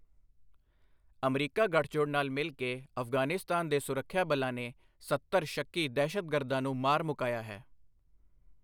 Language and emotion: Punjabi, neutral